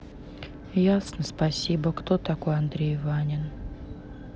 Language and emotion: Russian, sad